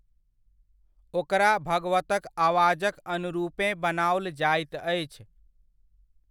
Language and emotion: Maithili, neutral